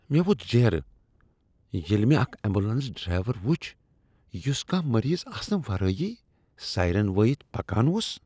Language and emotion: Kashmiri, disgusted